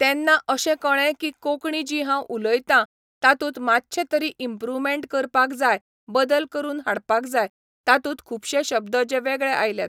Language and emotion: Goan Konkani, neutral